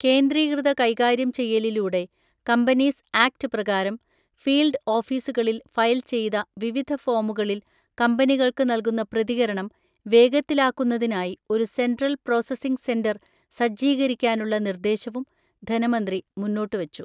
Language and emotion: Malayalam, neutral